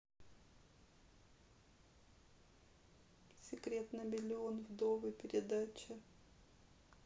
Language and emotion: Russian, sad